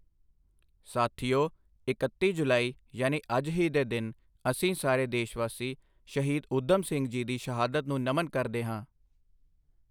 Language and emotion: Punjabi, neutral